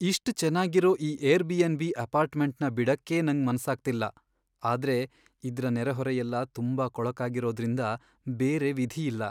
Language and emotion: Kannada, sad